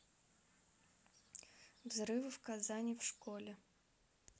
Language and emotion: Russian, neutral